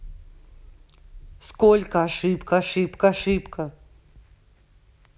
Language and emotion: Russian, angry